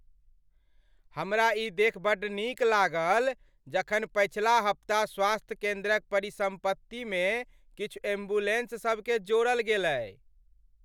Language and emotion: Maithili, happy